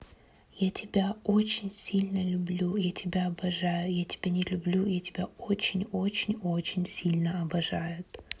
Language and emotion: Russian, neutral